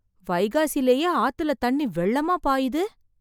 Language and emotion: Tamil, surprised